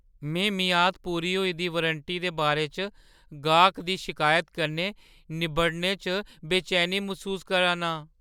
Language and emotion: Dogri, fearful